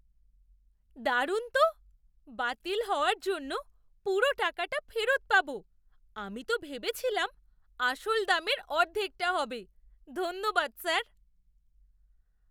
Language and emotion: Bengali, surprised